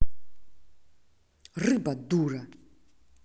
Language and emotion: Russian, angry